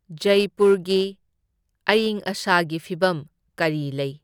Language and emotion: Manipuri, neutral